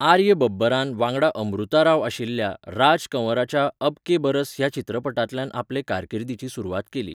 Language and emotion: Goan Konkani, neutral